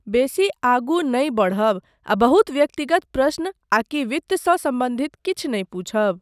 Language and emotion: Maithili, neutral